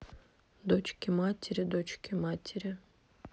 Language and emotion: Russian, neutral